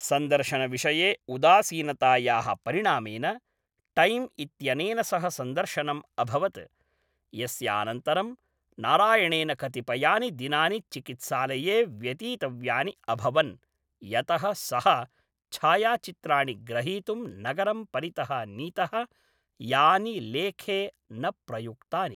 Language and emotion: Sanskrit, neutral